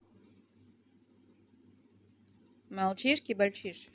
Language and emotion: Russian, neutral